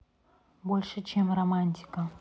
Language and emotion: Russian, neutral